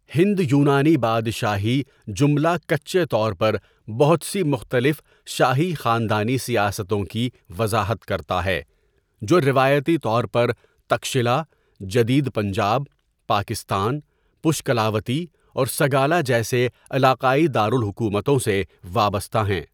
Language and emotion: Urdu, neutral